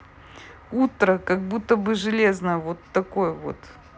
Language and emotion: Russian, positive